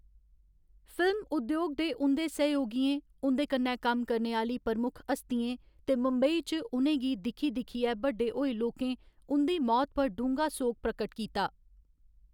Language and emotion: Dogri, neutral